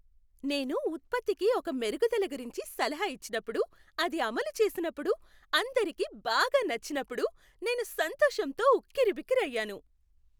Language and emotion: Telugu, happy